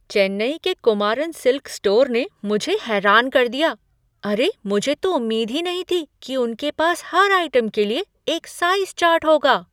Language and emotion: Hindi, surprised